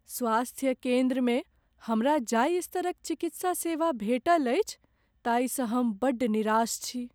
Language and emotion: Maithili, sad